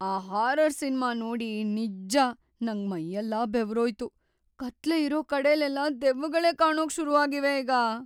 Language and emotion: Kannada, fearful